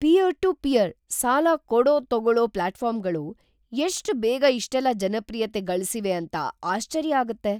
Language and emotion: Kannada, surprised